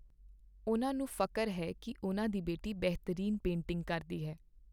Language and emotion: Punjabi, neutral